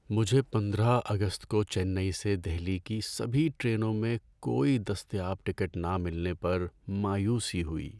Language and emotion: Urdu, sad